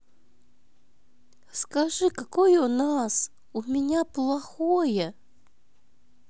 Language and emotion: Russian, sad